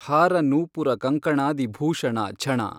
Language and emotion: Kannada, neutral